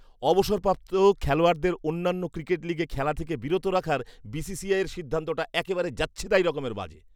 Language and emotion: Bengali, disgusted